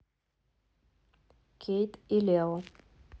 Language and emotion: Russian, neutral